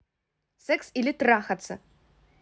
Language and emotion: Russian, angry